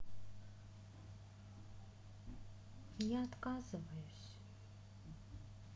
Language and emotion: Russian, sad